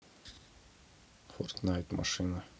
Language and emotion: Russian, neutral